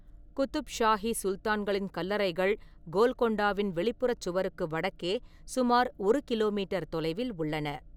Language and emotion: Tamil, neutral